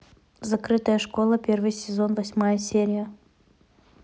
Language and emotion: Russian, neutral